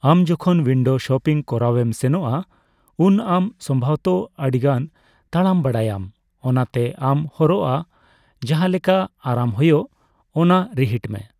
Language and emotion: Santali, neutral